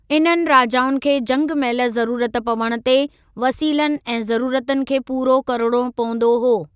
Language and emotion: Sindhi, neutral